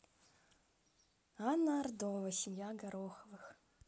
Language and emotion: Russian, positive